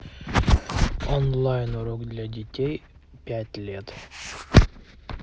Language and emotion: Russian, neutral